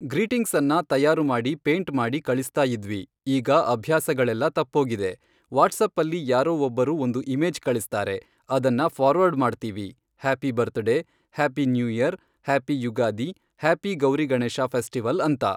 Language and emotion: Kannada, neutral